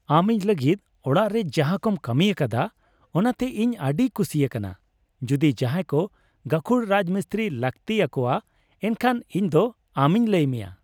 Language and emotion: Santali, happy